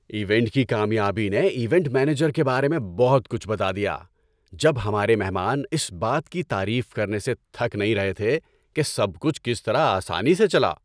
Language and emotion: Urdu, happy